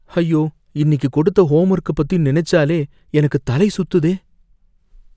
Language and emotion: Tamil, fearful